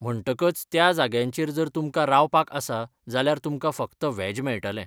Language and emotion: Goan Konkani, neutral